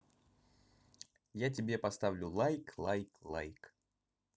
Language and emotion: Russian, positive